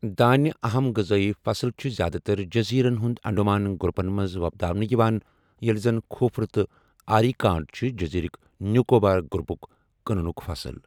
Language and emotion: Kashmiri, neutral